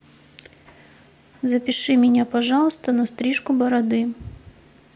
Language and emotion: Russian, neutral